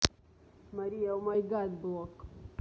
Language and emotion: Russian, neutral